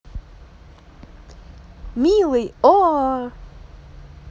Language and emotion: Russian, positive